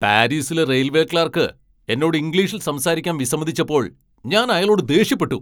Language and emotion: Malayalam, angry